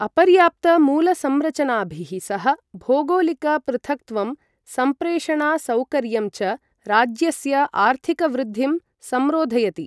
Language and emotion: Sanskrit, neutral